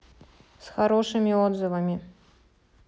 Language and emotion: Russian, neutral